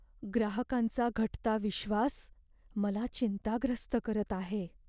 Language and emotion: Marathi, fearful